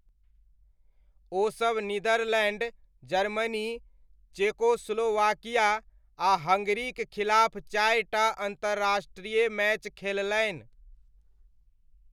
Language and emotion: Maithili, neutral